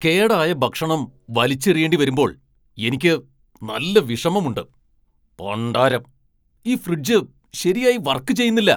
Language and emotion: Malayalam, angry